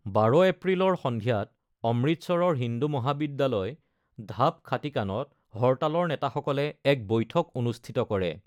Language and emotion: Assamese, neutral